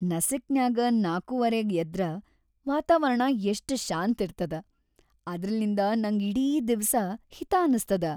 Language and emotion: Kannada, happy